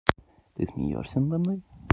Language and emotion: Russian, neutral